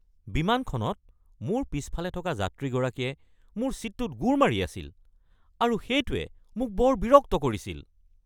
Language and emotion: Assamese, angry